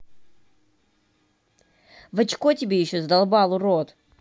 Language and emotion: Russian, angry